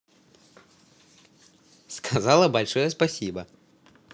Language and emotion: Russian, positive